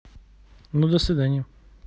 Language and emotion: Russian, neutral